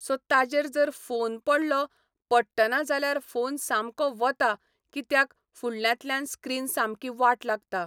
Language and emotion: Goan Konkani, neutral